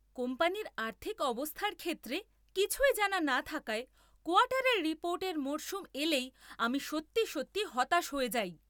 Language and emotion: Bengali, angry